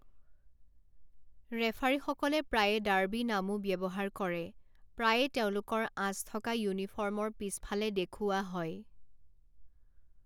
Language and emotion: Assamese, neutral